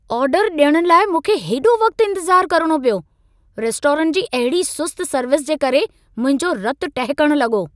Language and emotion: Sindhi, angry